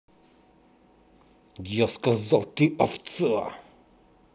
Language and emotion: Russian, angry